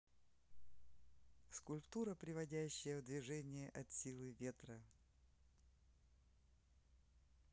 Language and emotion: Russian, neutral